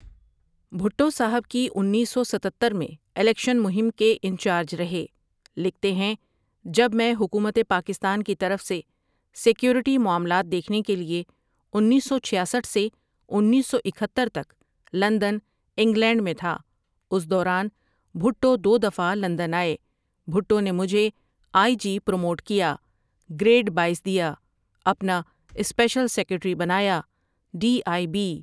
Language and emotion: Urdu, neutral